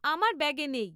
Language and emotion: Bengali, neutral